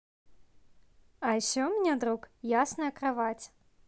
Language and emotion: Russian, positive